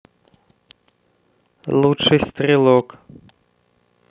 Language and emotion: Russian, neutral